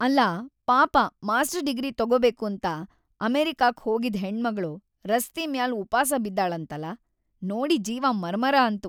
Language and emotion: Kannada, sad